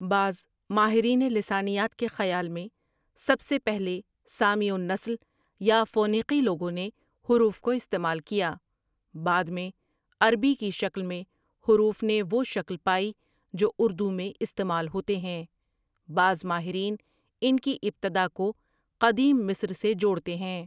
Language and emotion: Urdu, neutral